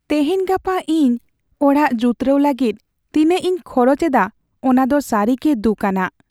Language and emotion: Santali, sad